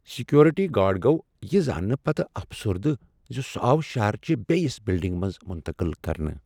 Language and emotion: Kashmiri, sad